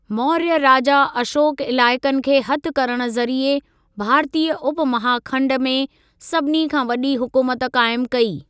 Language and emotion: Sindhi, neutral